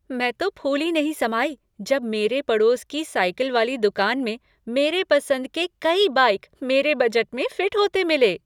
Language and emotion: Hindi, happy